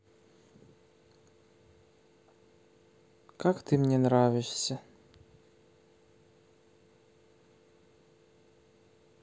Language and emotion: Russian, neutral